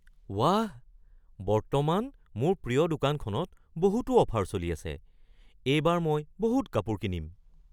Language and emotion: Assamese, surprised